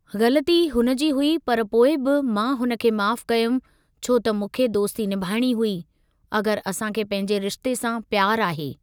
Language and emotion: Sindhi, neutral